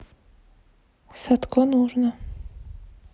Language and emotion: Russian, neutral